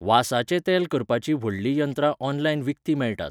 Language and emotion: Goan Konkani, neutral